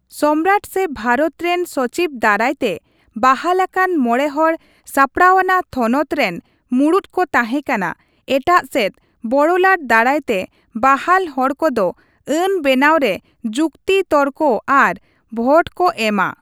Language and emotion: Santali, neutral